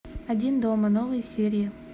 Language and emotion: Russian, neutral